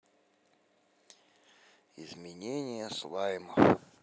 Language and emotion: Russian, sad